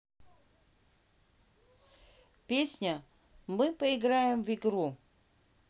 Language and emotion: Russian, neutral